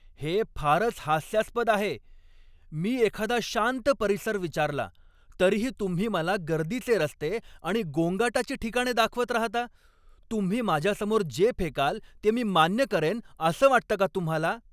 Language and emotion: Marathi, angry